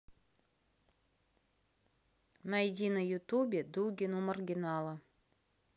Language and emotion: Russian, neutral